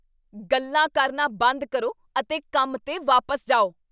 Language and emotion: Punjabi, angry